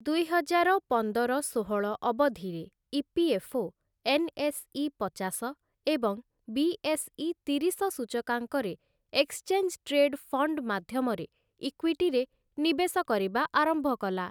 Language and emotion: Odia, neutral